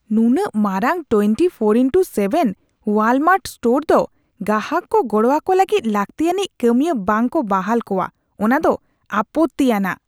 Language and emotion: Santali, disgusted